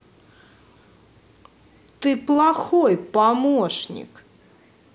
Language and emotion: Russian, angry